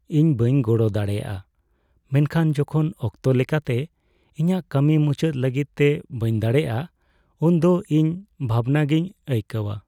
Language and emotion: Santali, sad